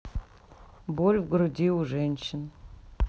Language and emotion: Russian, sad